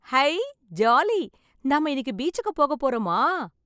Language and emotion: Tamil, happy